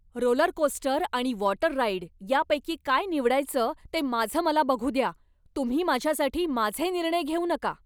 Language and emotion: Marathi, angry